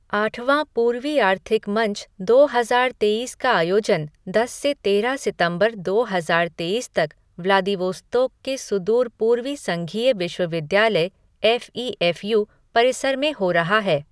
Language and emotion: Hindi, neutral